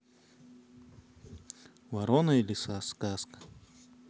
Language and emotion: Russian, neutral